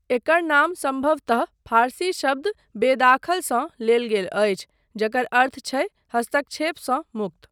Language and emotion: Maithili, neutral